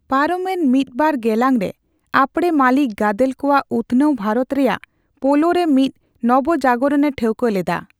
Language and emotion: Santali, neutral